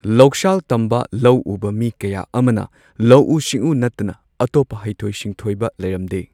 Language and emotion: Manipuri, neutral